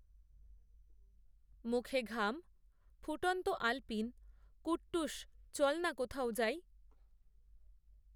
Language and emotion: Bengali, neutral